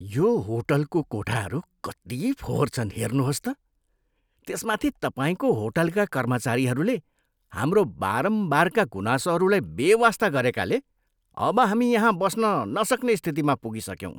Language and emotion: Nepali, disgusted